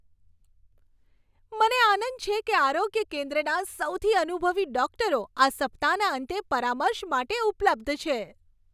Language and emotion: Gujarati, happy